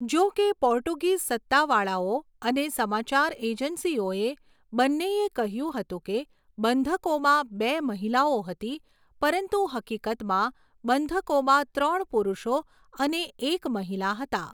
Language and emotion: Gujarati, neutral